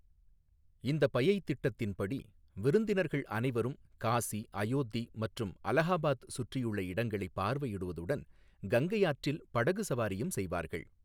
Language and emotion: Tamil, neutral